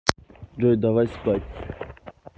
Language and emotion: Russian, neutral